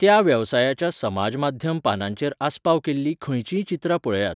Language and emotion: Goan Konkani, neutral